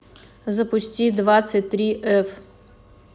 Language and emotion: Russian, neutral